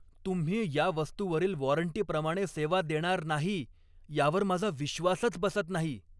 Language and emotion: Marathi, angry